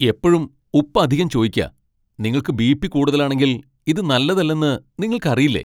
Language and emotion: Malayalam, angry